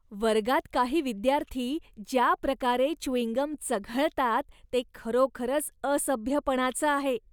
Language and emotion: Marathi, disgusted